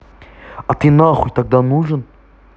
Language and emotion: Russian, angry